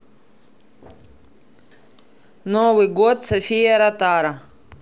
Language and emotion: Russian, neutral